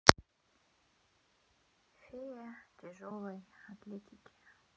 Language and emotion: Russian, sad